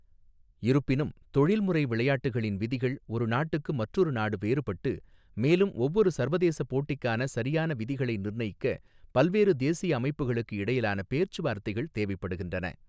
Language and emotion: Tamil, neutral